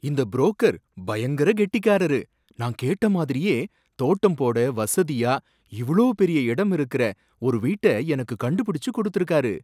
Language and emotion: Tamil, surprised